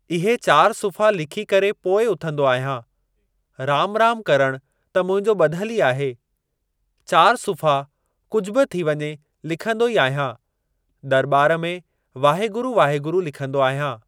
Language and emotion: Sindhi, neutral